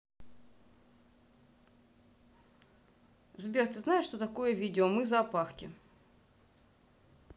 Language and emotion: Russian, neutral